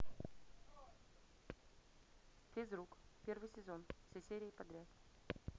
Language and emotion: Russian, neutral